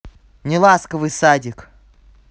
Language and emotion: Russian, angry